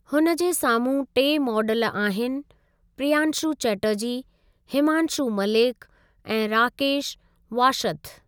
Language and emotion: Sindhi, neutral